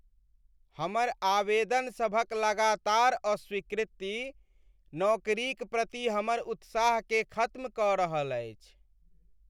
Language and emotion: Maithili, sad